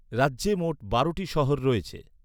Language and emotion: Bengali, neutral